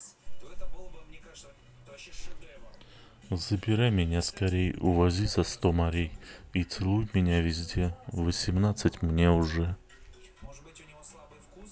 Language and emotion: Russian, neutral